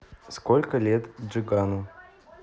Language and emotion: Russian, neutral